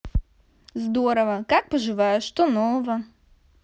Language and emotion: Russian, positive